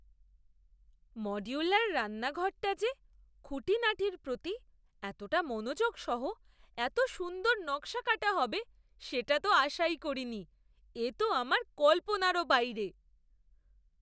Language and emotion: Bengali, surprised